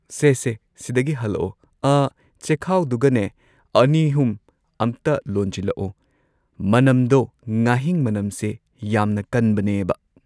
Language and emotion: Manipuri, neutral